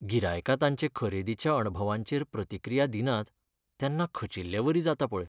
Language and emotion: Goan Konkani, sad